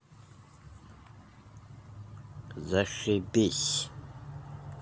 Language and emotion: Russian, angry